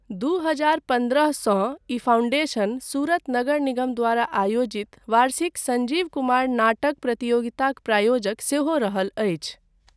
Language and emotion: Maithili, neutral